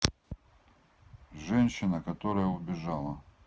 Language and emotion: Russian, neutral